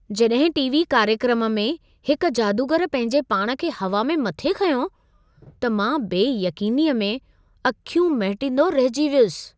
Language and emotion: Sindhi, surprised